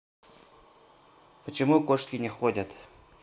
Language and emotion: Russian, neutral